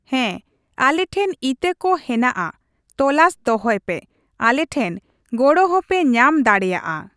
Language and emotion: Santali, neutral